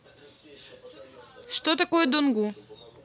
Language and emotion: Russian, neutral